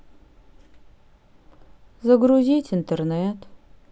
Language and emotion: Russian, sad